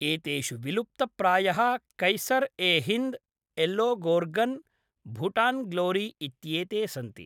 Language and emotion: Sanskrit, neutral